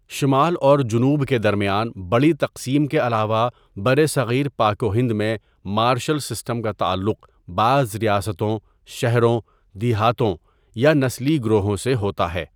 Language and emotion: Urdu, neutral